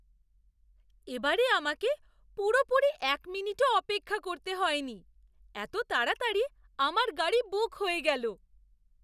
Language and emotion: Bengali, surprised